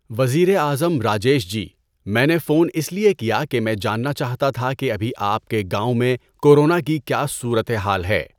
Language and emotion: Urdu, neutral